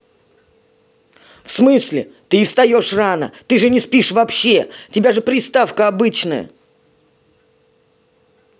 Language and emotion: Russian, angry